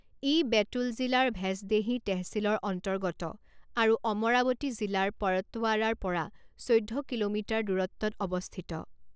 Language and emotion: Assamese, neutral